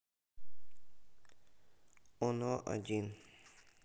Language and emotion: Russian, sad